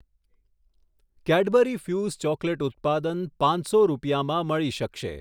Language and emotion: Gujarati, neutral